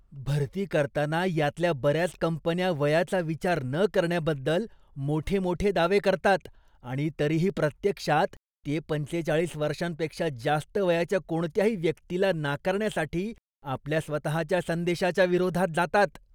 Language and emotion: Marathi, disgusted